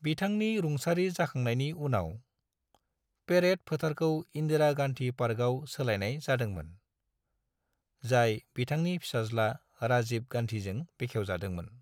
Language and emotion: Bodo, neutral